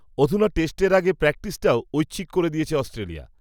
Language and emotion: Bengali, neutral